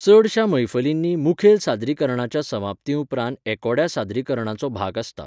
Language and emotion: Goan Konkani, neutral